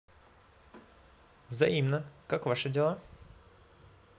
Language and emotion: Russian, positive